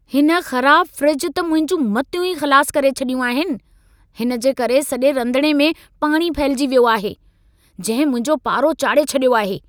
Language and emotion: Sindhi, angry